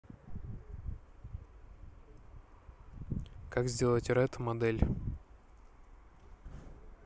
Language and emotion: Russian, neutral